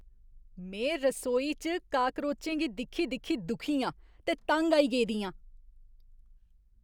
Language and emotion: Dogri, disgusted